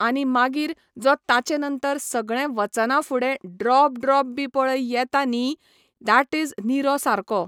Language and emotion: Goan Konkani, neutral